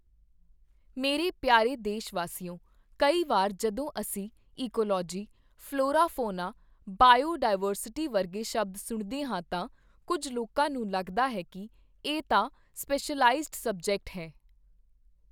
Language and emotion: Punjabi, neutral